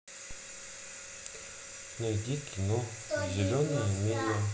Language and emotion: Russian, neutral